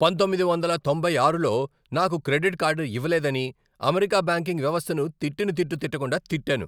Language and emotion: Telugu, angry